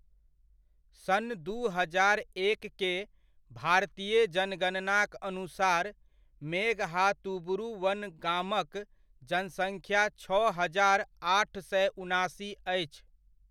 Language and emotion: Maithili, neutral